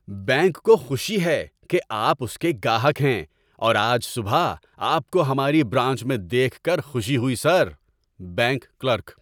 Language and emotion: Urdu, happy